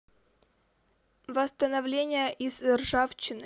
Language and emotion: Russian, neutral